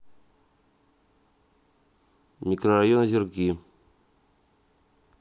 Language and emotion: Russian, neutral